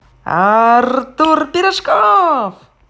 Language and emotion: Russian, positive